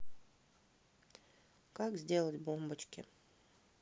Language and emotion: Russian, neutral